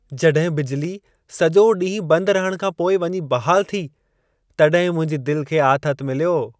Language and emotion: Sindhi, happy